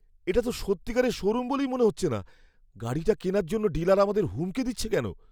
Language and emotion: Bengali, fearful